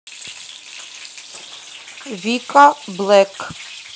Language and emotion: Russian, neutral